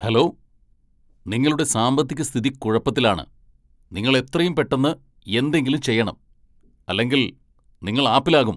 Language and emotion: Malayalam, angry